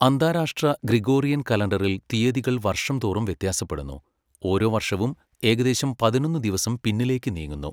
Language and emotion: Malayalam, neutral